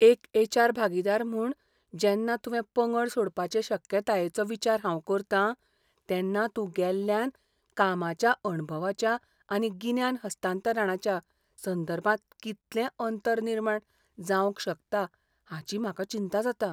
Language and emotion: Goan Konkani, fearful